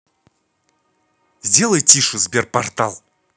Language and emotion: Russian, angry